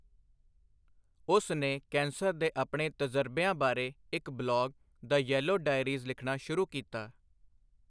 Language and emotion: Punjabi, neutral